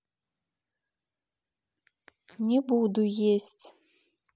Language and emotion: Russian, neutral